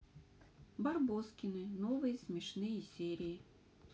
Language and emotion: Russian, neutral